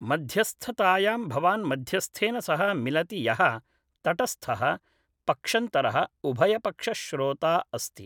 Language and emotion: Sanskrit, neutral